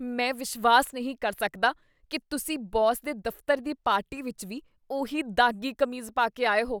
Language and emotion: Punjabi, disgusted